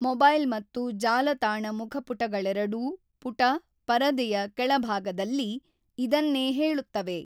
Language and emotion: Kannada, neutral